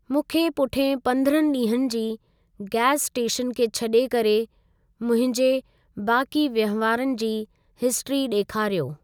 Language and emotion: Sindhi, neutral